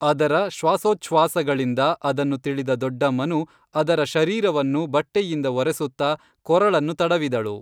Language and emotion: Kannada, neutral